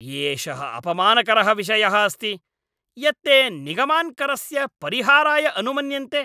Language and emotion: Sanskrit, angry